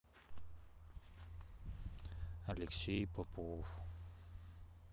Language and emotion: Russian, sad